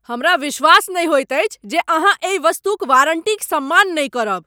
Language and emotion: Maithili, angry